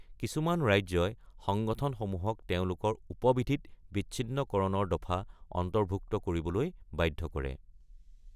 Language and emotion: Assamese, neutral